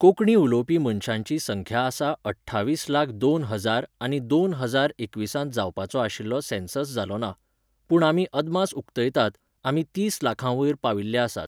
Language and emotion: Goan Konkani, neutral